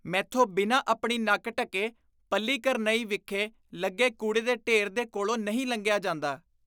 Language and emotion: Punjabi, disgusted